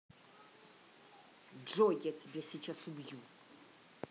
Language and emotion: Russian, angry